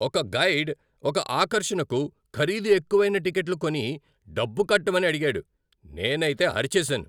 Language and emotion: Telugu, angry